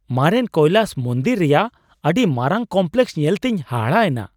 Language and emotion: Santali, surprised